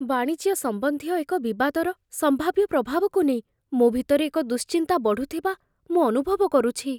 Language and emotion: Odia, fearful